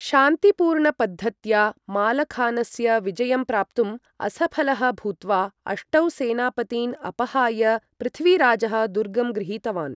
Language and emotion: Sanskrit, neutral